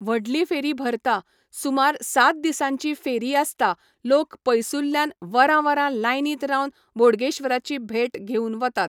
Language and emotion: Goan Konkani, neutral